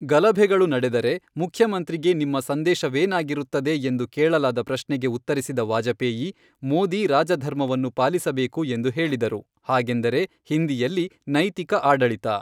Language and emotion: Kannada, neutral